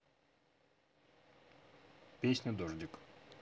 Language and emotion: Russian, neutral